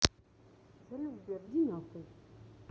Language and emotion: Russian, neutral